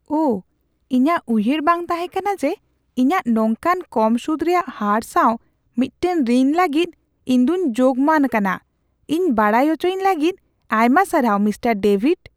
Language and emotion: Santali, surprised